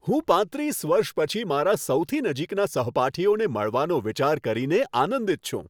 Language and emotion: Gujarati, happy